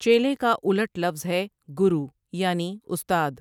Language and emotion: Urdu, neutral